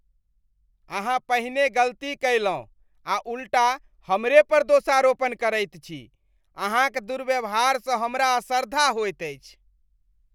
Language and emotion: Maithili, disgusted